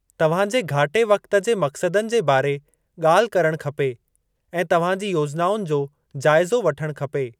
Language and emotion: Sindhi, neutral